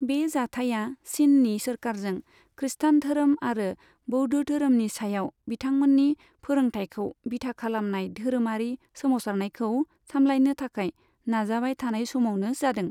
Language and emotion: Bodo, neutral